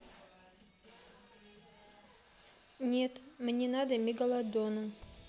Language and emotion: Russian, neutral